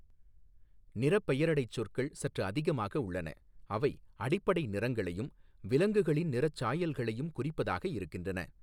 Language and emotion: Tamil, neutral